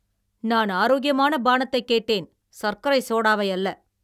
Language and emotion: Tamil, angry